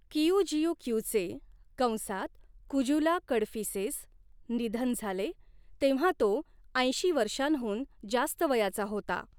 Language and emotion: Marathi, neutral